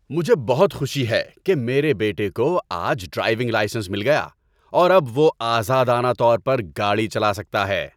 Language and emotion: Urdu, happy